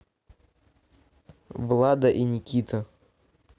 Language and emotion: Russian, neutral